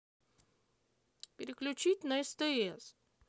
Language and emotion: Russian, sad